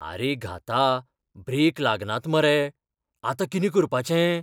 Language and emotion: Goan Konkani, fearful